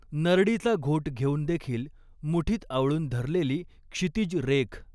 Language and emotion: Marathi, neutral